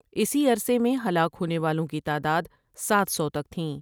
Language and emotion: Urdu, neutral